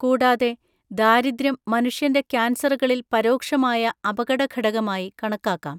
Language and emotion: Malayalam, neutral